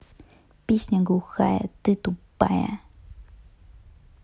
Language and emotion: Russian, neutral